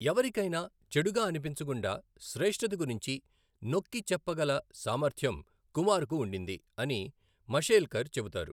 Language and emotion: Telugu, neutral